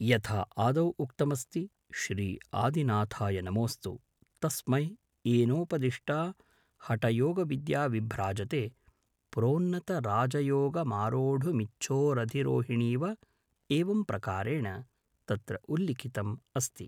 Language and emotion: Sanskrit, neutral